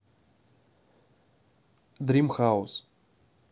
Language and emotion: Russian, neutral